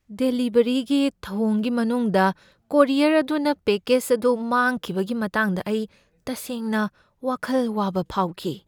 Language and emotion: Manipuri, fearful